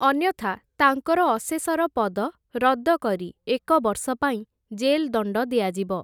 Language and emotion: Odia, neutral